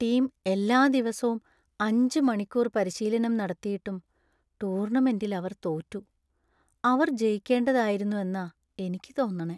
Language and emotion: Malayalam, sad